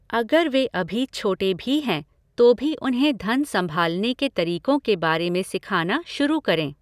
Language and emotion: Hindi, neutral